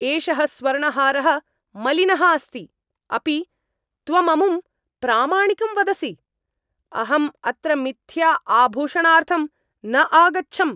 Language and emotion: Sanskrit, angry